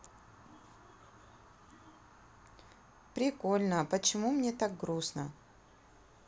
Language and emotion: Russian, neutral